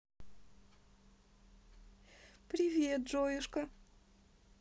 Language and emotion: Russian, positive